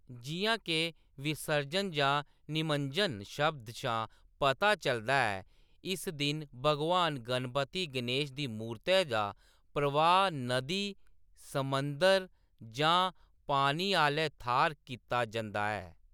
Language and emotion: Dogri, neutral